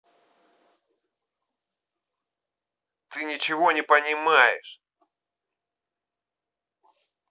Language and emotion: Russian, angry